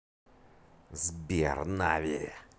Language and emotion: Russian, angry